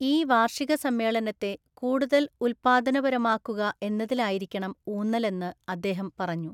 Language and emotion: Malayalam, neutral